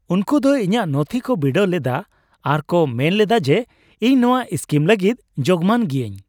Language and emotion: Santali, happy